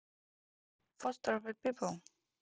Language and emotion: Russian, neutral